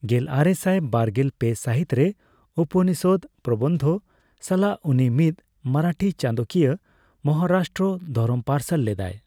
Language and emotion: Santali, neutral